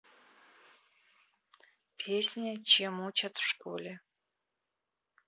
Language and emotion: Russian, neutral